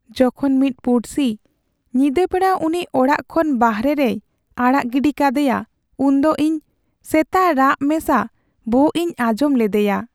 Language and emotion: Santali, sad